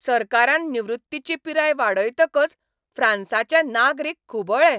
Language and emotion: Goan Konkani, angry